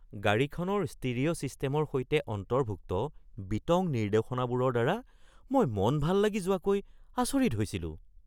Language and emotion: Assamese, surprised